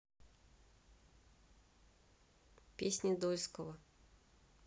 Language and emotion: Russian, neutral